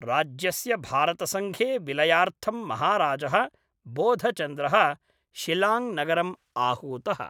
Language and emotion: Sanskrit, neutral